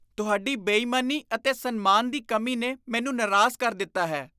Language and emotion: Punjabi, disgusted